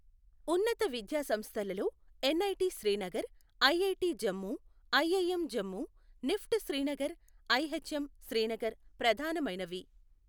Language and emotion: Telugu, neutral